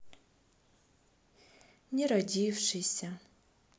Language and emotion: Russian, sad